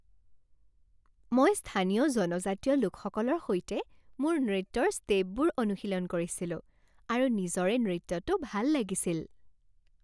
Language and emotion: Assamese, happy